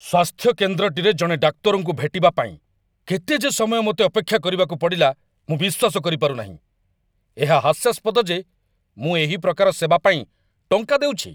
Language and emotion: Odia, angry